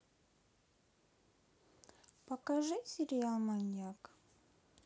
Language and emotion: Russian, neutral